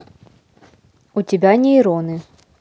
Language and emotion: Russian, neutral